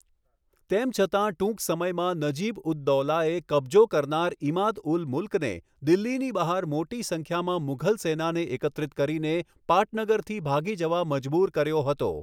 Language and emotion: Gujarati, neutral